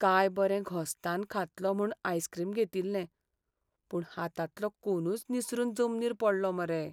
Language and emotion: Goan Konkani, sad